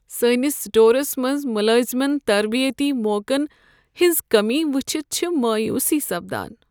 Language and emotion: Kashmiri, sad